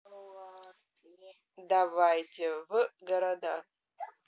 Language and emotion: Russian, neutral